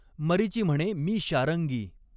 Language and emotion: Marathi, neutral